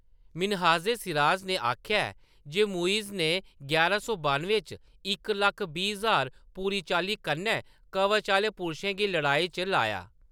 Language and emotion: Dogri, neutral